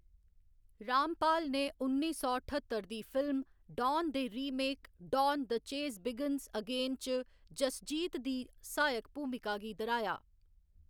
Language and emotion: Dogri, neutral